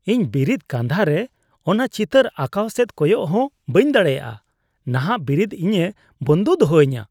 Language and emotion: Santali, disgusted